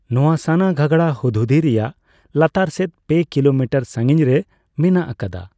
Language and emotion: Santali, neutral